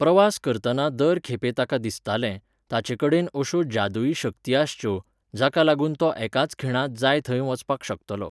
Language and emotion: Goan Konkani, neutral